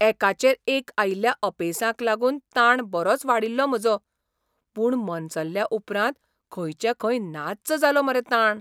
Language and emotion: Goan Konkani, surprised